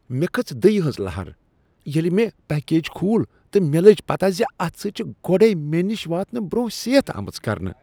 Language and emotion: Kashmiri, disgusted